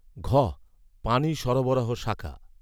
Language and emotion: Bengali, neutral